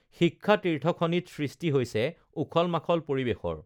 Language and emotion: Assamese, neutral